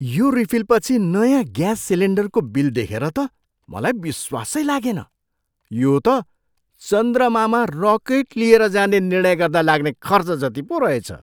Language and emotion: Nepali, surprised